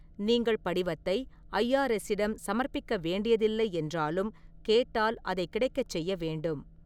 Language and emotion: Tamil, neutral